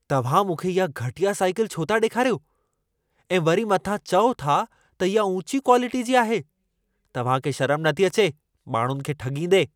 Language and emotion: Sindhi, angry